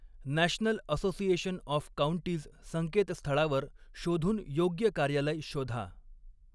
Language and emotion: Marathi, neutral